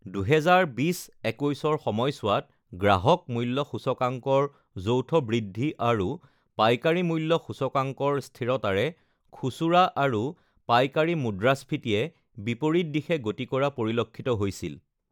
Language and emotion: Assamese, neutral